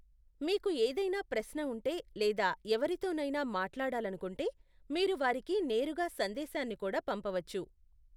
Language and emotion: Telugu, neutral